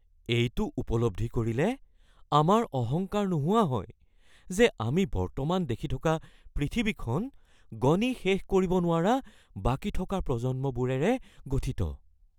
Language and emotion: Assamese, fearful